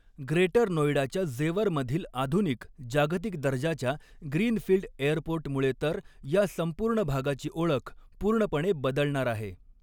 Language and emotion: Marathi, neutral